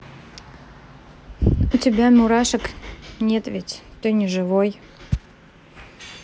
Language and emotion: Russian, neutral